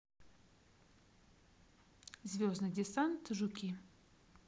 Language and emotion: Russian, neutral